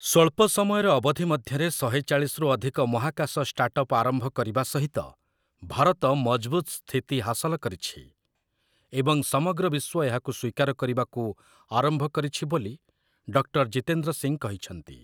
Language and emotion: Odia, neutral